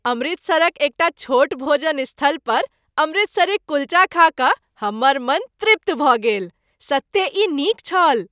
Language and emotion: Maithili, happy